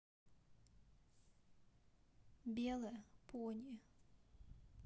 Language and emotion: Russian, sad